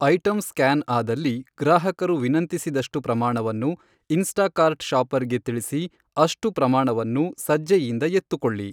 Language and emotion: Kannada, neutral